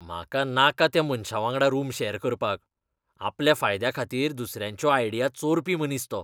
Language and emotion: Goan Konkani, disgusted